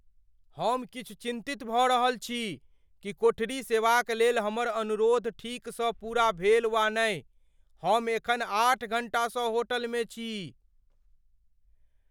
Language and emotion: Maithili, fearful